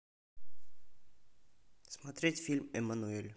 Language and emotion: Russian, neutral